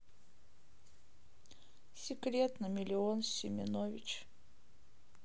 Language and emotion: Russian, sad